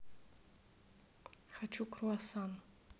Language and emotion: Russian, neutral